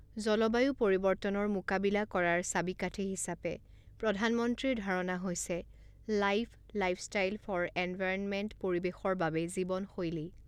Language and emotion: Assamese, neutral